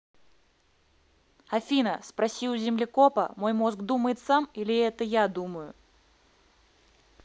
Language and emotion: Russian, neutral